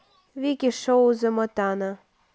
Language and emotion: Russian, neutral